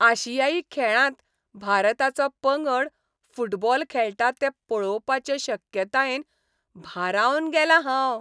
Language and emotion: Goan Konkani, happy